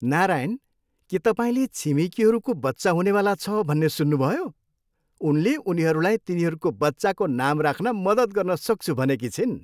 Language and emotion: Nepali, happy